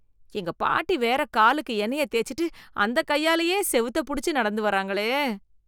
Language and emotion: Tamil, disgusted